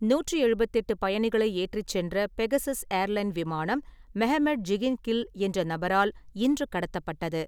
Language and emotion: Tamil, neutral